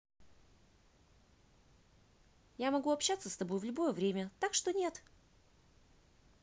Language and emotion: Russian, positive